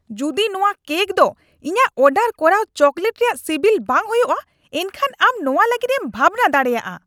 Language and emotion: Santali, angry